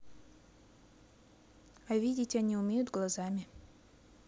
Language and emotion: Russian, neutral